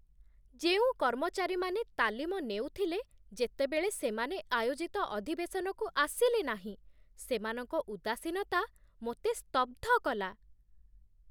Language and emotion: Odia, surprised